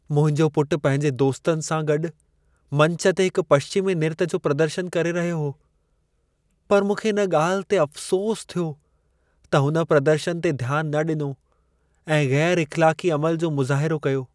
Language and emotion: Sindhi, sad